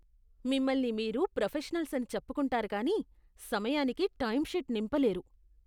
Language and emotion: Telugu, disgusted